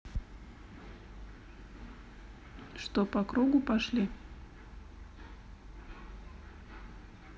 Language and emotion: Russian, neutral